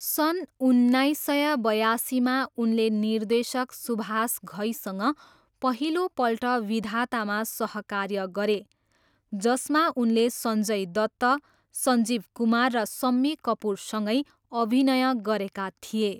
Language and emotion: Nepali, neutral